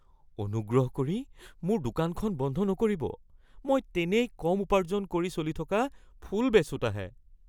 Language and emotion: Assamese, fearful